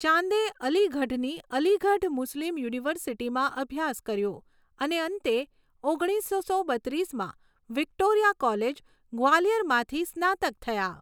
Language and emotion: Gujarati, neutral